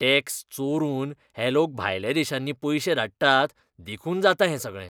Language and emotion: Goan Konkani, disgusted